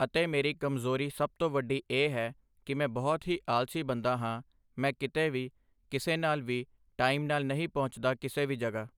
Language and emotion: Punjabi, neutral